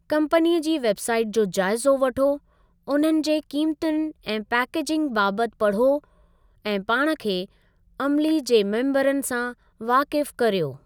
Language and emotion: Sindhi, neutral